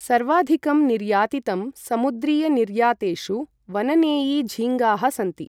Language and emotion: Sanskrit, neutral